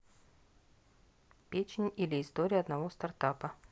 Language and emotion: Russian, neutral